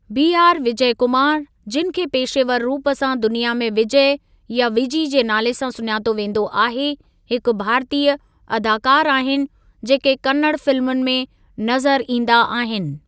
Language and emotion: Sindhi, neutral